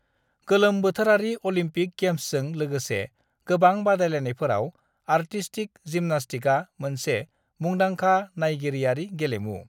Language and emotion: Bodo, neutral